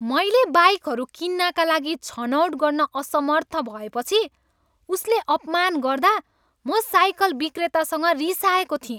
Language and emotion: Nepali, angry